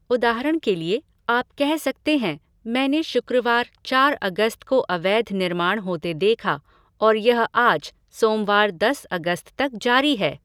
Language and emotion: Hindi, neutral